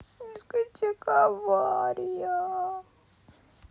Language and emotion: Russian, sad